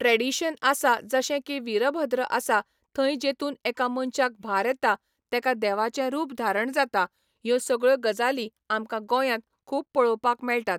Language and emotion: Goan Konkani, neutral